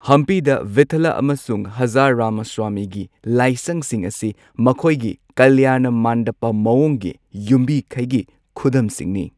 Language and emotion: Manipuri, neutral